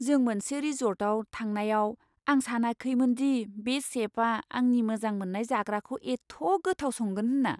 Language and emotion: Bodo, surprised